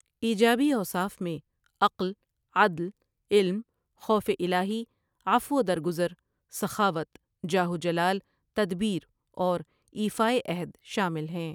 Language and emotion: Urdu, neutral